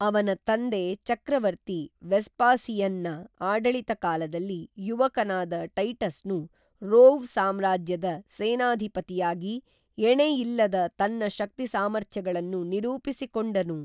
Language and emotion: Kannada, neutral